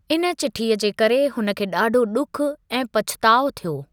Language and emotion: Sindhi, neutral